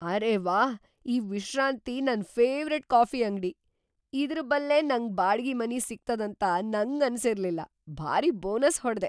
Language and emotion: Kannada, surprised